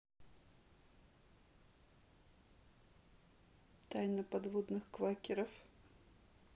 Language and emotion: Russian, neutral